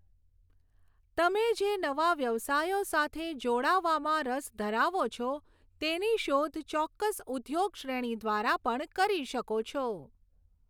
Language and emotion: Gujarati, neutral